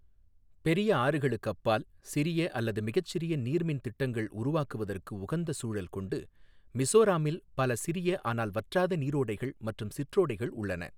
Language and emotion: Tamil, neutral